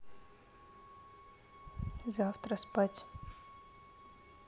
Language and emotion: Russian, neutral